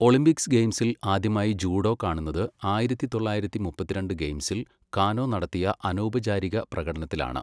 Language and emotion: Malayalam, neutral